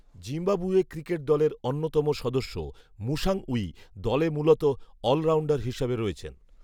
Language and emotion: Bengali, neutral